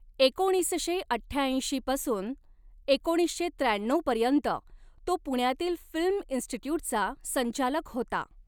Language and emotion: Marathi, neutral